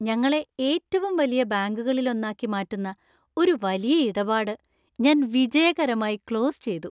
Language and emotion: Malayalam, happy